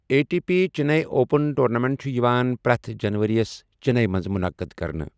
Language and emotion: Kashmiri, neutral